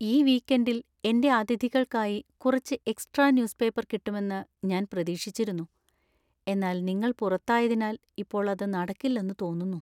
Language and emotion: Malayalam, sad